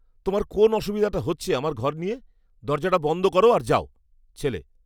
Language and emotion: Bengali, angry